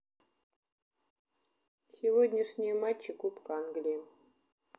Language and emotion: Russian, neutral